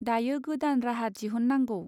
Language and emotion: Bodo, neutral